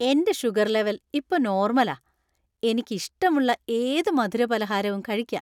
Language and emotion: Malayalam, happy